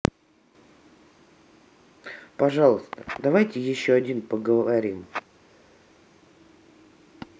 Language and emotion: Russian, neutral